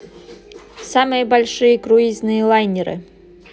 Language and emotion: Russian, neutral